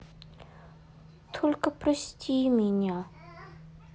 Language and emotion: Russian, sad